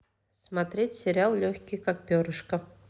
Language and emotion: Russian, neutral